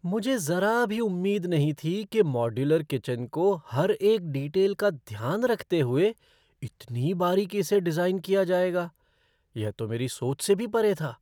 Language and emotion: Hindi, surprised